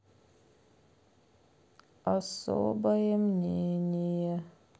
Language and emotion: Russian, sad